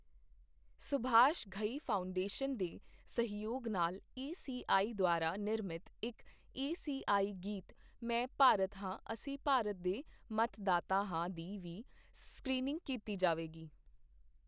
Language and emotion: Punjabi, neutral